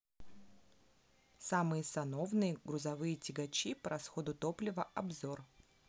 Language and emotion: Russian, neutral